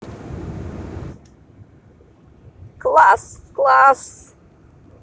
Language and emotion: Russian, positive